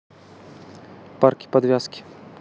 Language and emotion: Russian, neutral